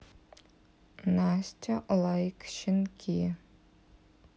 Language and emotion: Russian, neutral